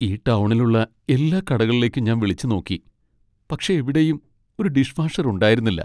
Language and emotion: Malayalam, sad